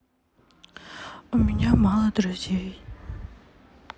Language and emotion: Russian, sad